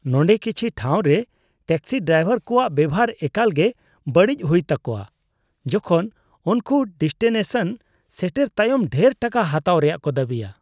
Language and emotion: Santali, disgusted